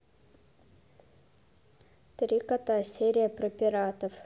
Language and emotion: Russian, neutral